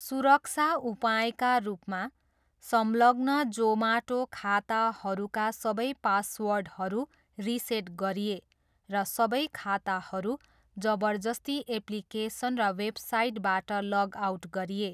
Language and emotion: Nepali, neutral